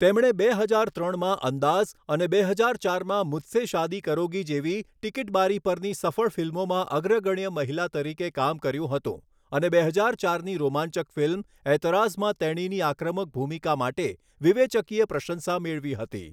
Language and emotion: Gujarati, neutral